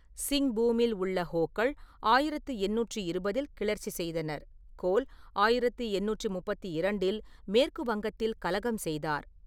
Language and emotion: Tamil, neutral